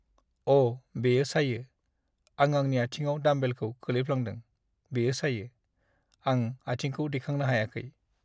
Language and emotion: Bodo, sad